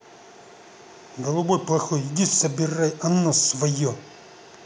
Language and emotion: Russian, angry